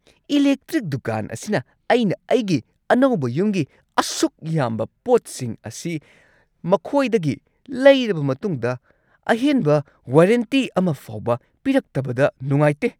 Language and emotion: Manipuri, angry